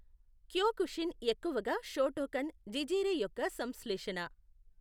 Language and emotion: Telugu, neutral